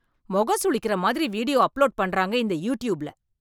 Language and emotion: Tamil, angry